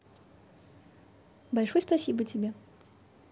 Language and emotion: Russian, positive